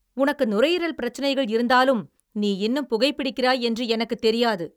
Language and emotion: Tamil, angry